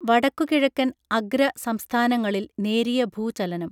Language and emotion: Malayalam, neutral